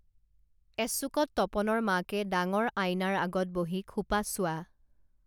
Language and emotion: Assamese, neutral